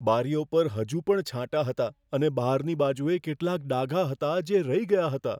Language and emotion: Gujarati, fearful